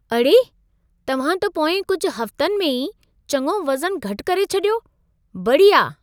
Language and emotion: Sindhi, surprised